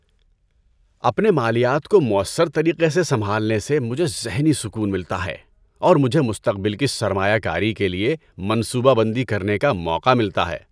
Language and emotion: Urdu, happy